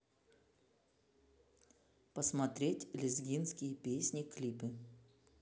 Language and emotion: Russian, neutral